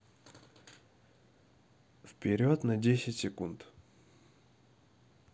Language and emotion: Russian, neutral